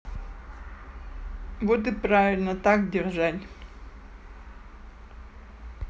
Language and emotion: Russian, neutral